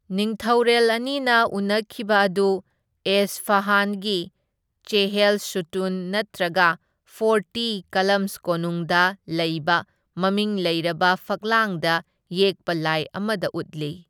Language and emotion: Manipuri, neutral